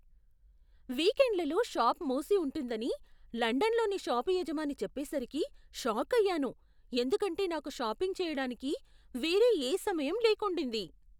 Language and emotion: Telugu, surprised